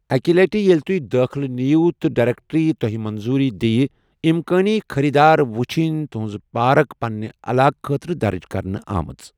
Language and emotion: Kashmiri, neutral